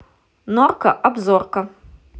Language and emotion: Russian, positive